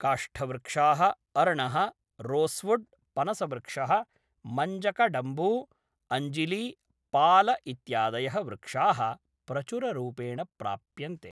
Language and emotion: Sanskrit, neutral